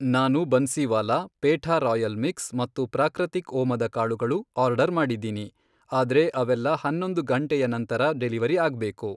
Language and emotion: Kannada, neutral